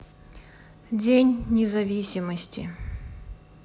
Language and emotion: Russian, sad